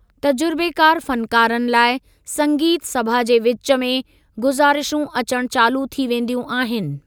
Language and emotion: Sindhi, neutral